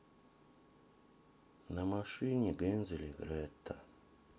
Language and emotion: Russian, sad